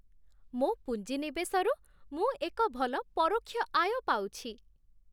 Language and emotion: Odia, happy